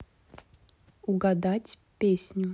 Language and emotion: Russian, neutral